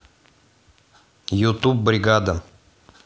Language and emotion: Russian, neutral